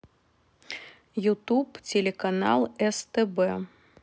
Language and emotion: Russian, neutral